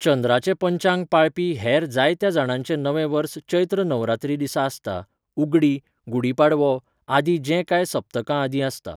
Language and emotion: Goan Konkani, neutral